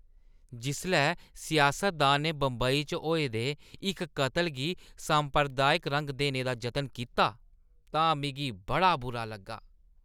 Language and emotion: Dogri, disgusted